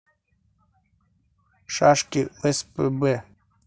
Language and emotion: Russian, neutral